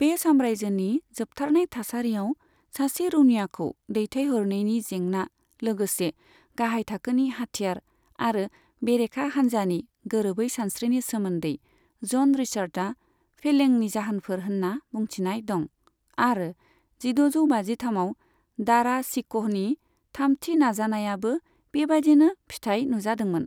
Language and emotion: Bodo, neutral